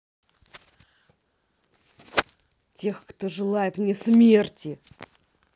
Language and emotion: Russian, angry